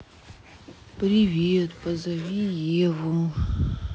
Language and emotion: Russian, sad